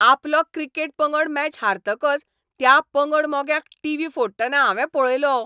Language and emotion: Goan Konkani, angry